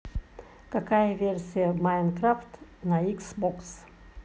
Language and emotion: Russian, neutral